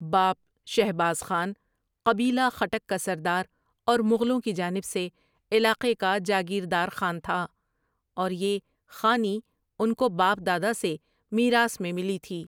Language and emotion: Urdu, neutral